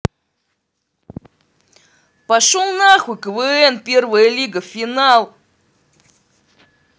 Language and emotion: Russian, angry